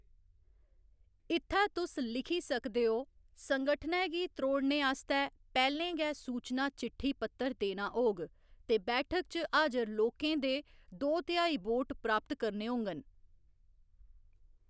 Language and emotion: Dogri, neutral